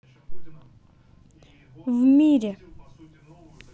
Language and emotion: Russian, neutral